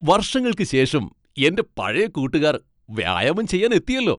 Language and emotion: Malayalam, happy